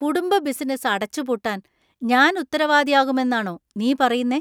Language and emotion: Malayalam, disgusted